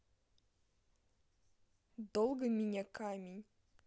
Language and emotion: Russian, sad